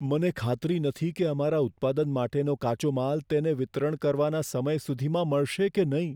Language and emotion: Gujarati, fearful